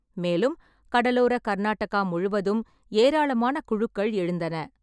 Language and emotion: Tamil, neutral